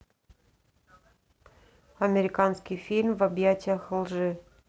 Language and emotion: Russian, neutral